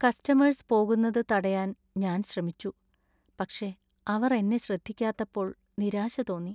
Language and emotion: Malayalam, sad